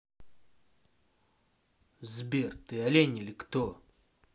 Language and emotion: Russian, angry